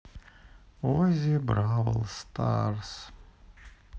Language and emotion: Russian, sad